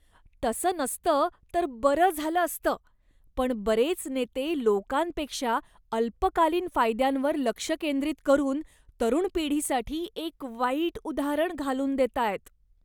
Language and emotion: Marathi, disgusted